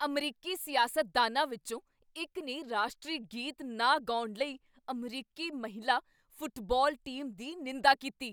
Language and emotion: Punjabi, angry